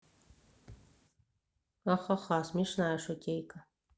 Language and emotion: Russian, neutral